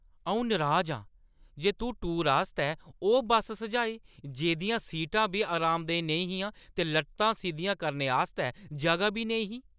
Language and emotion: Dogri, angry